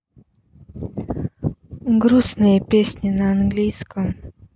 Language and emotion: Russian, sad